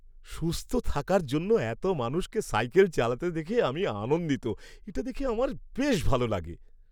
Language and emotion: Bengali, happy